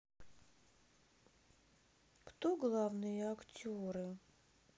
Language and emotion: Russian, sad